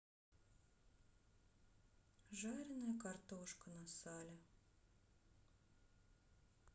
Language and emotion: Russian, sad